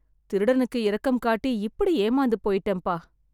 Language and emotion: Tamil, sad